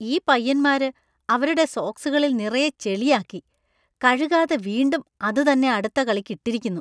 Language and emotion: Malayalam, disgusted